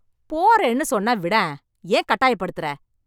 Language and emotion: Tamil, angry